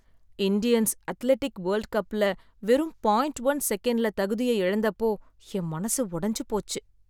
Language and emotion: Tamil, sad